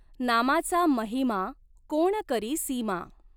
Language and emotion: Marathi, neutral